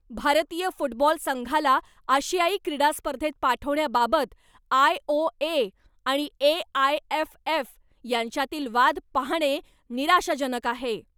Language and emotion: Marathi, angry